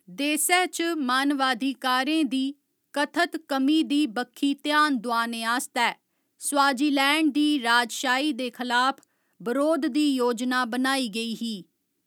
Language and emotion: Dogri, neutral